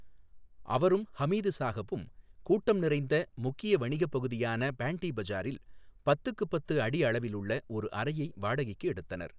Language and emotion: Tamil, neutral